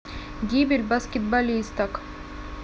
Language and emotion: Russian, neutral